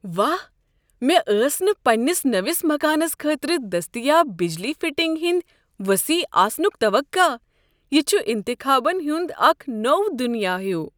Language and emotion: Kashmiri, surprised